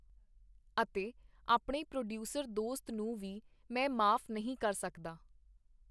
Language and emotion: Punjabi, neutral